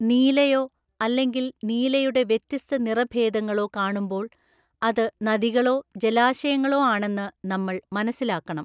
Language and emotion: Malayalam, neutral